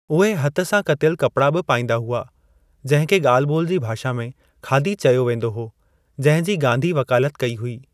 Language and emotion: Sindhi, neutral